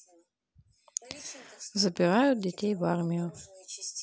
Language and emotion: Russian, neutral